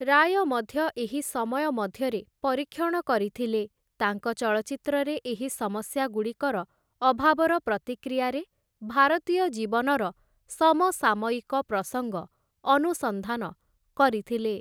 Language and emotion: Odia, neutral